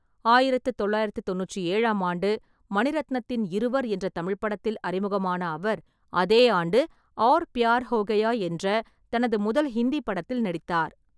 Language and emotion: Tamil, neutral